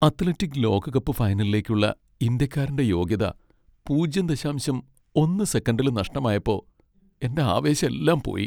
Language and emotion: Malayalam, sad